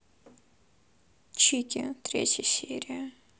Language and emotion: Russian, sad